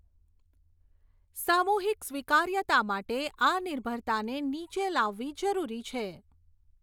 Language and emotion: Gujarati, neutral